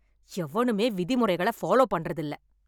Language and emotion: Tamil, angry